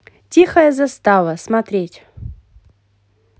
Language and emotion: Russian, positive